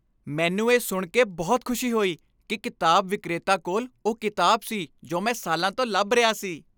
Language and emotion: Punjabi, happy